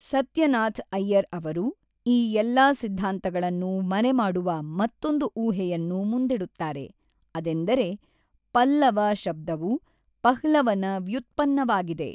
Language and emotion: Kannada, neutral